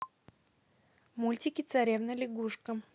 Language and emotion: Russian, neutral